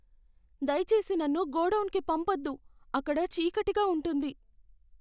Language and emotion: Telugu, fearful